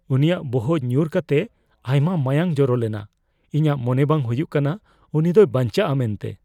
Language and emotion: Santali, fearful